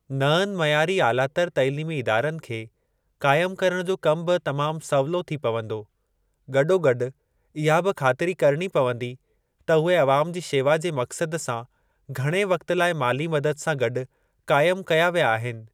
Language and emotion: Sindhi, neutral